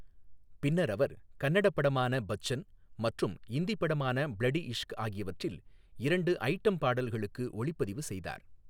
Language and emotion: Tamil, neutral